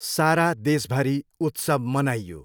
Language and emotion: Nepali, neutral